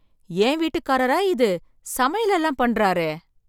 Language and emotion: Tamil, surprised